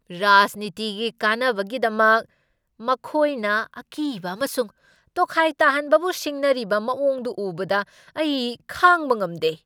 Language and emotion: Manipuri, angry